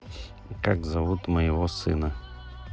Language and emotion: Russian, neutral